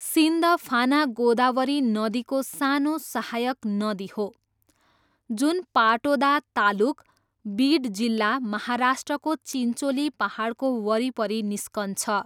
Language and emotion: Nepali, neutral